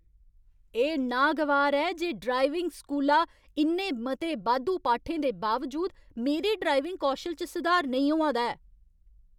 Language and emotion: Dogri, angry